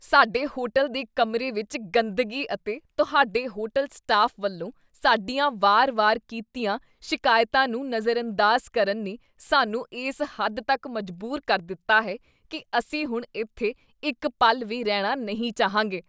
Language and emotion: Punjabi, disgusted